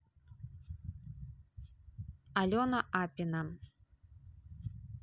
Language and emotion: Russian, neutral